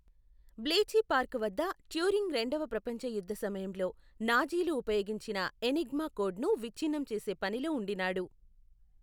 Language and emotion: Telugu, neutral